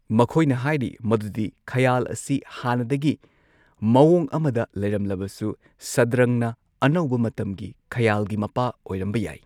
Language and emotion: Manipuri, neutral